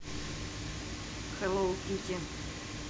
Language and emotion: Russian, neutral